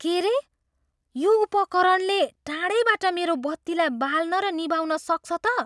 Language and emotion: Nepali, surprised